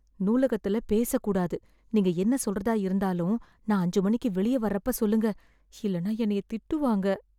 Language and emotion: Tamil, fearful